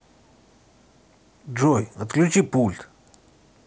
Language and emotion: Russian, neutral